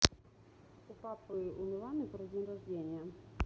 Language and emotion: Russian, neutral